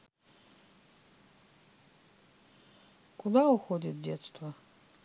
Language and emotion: Russian, sad